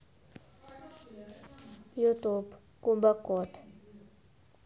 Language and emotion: Russian, neutral